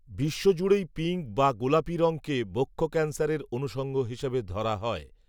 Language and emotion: Bengali, neutral